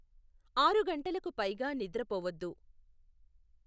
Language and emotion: Telugu, neutral